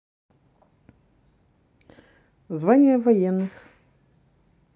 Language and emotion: Russian, neutral